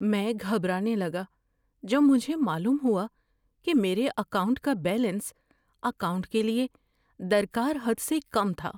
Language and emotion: Urdu, fearful